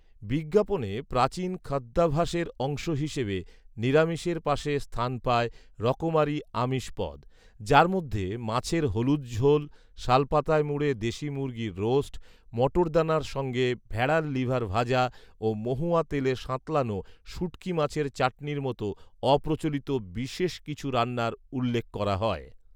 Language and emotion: Bengali, neutral